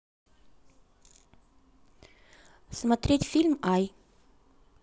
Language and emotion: Russian, neutral